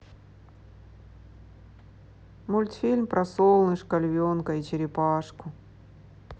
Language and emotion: Russian, sad